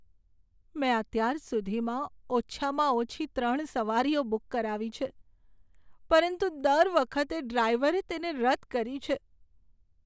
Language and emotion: Gujarati, sad